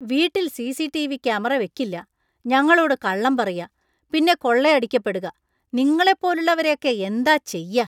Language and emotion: Malayalam, disgusted